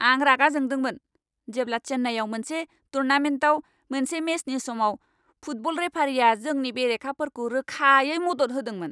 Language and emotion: Bodo, angry